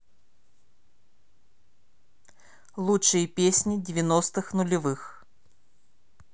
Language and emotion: Russian, neutral